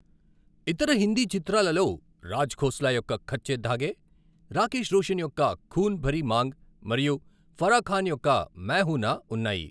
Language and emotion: Telugu, neutral